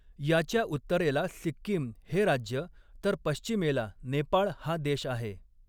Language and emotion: Marathi, neutral